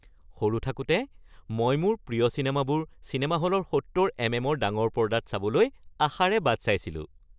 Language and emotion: Assamese, happy